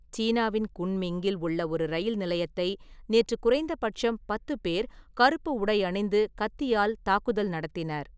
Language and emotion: Tamil, neutral